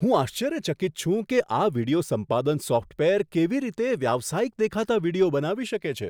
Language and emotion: Gujarati, surprised